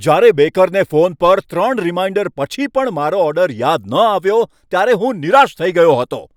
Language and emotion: Gujarati, angry